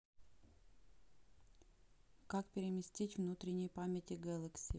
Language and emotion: Russian, neutral